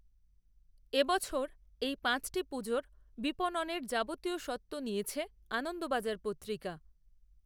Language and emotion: Bengali, neutral